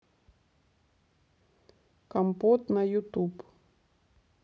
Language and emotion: Russian, neutral